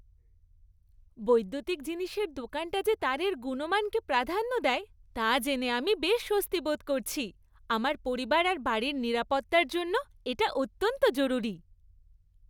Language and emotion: Bengali, happy